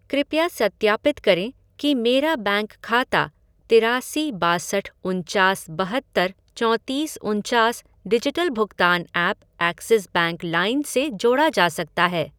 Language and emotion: Hindi, neutral